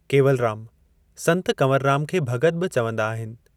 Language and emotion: Sindhi, neutral